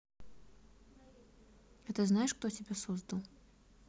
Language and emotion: Russian, neutral